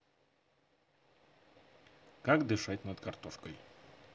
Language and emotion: Russian, positive